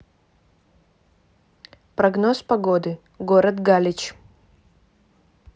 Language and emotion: Russian, neutral